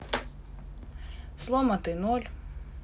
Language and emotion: Russian, neutral